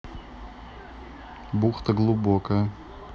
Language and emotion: Russian, neutral